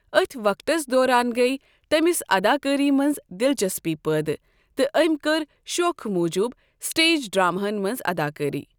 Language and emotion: Kashmiri, neutral